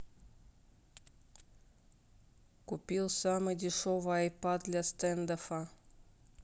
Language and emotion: Russian, neutral